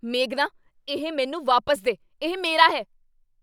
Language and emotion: Punjabi, angry